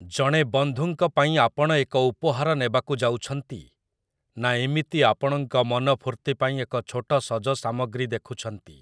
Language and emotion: Odia, neutral